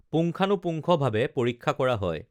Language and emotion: Assamese, neutral